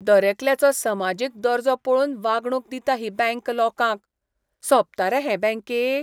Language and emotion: Goan Konkani, disgusted